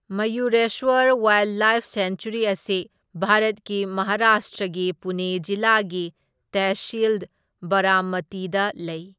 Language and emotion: Manipuri, neutral